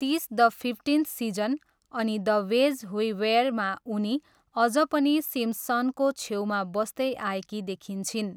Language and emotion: Nepali, neutral